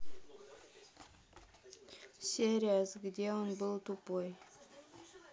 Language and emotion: Russian, neutral